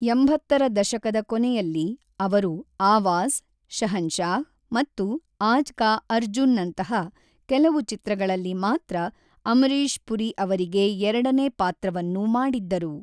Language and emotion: Kannada, neutral